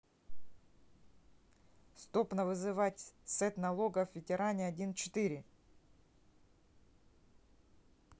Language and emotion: Russian, neutral